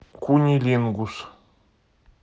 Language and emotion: Russian, neutral